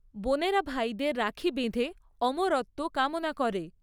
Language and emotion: Bengali, neutral